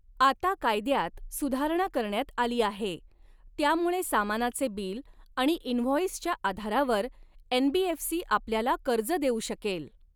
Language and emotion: Marathi, neutral